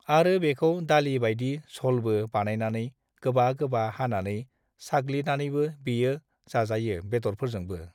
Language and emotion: Bodo, neutral